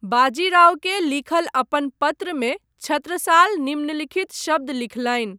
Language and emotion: Maithili, neutral